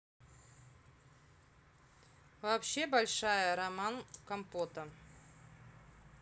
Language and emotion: Russian, neutral